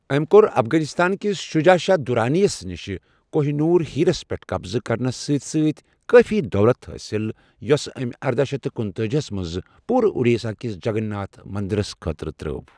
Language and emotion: Kashmiri, neutral